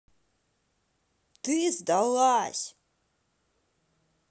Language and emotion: Russian, angry